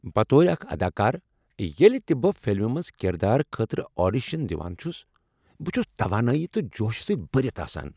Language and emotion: Kashmiri, happy